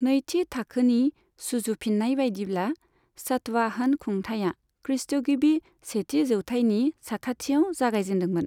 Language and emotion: Bodo, neutral